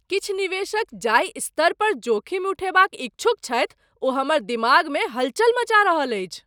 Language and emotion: Maithili, surprised